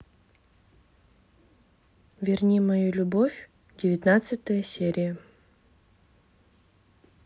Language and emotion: Russian, neutral